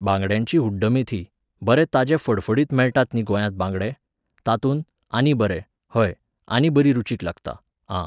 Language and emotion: Goan Konkani, neutral